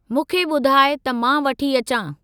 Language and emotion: Sindhi, neutral